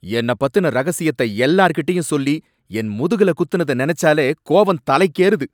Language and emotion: Tamil, angry